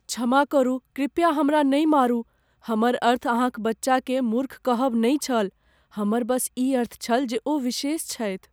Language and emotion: Maithili, fearful